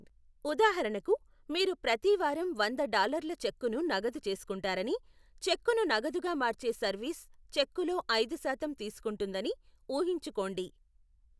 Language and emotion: Telugu, neutral